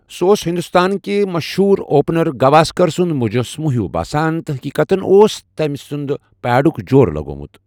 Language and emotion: Kashmiri, neutral